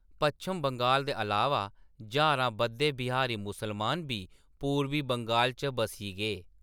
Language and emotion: Dogri, neutral